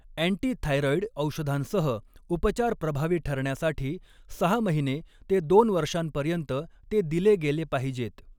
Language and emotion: Marathi, neutral